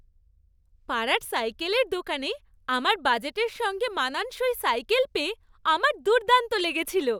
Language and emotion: Bengali, happy